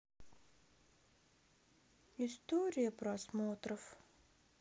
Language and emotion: Russian, sad